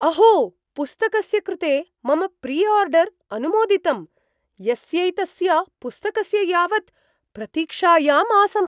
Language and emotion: Sanskrit, surprised